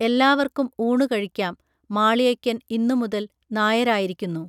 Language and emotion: Malayalam, neutral